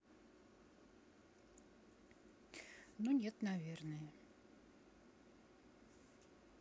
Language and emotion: Russian, neutral